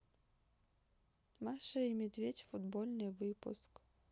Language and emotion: Russian, sad